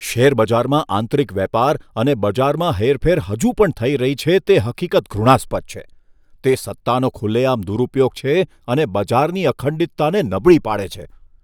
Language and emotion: Gujarati, disgusted